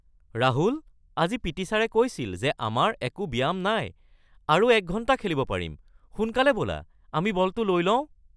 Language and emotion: Assamese, surprised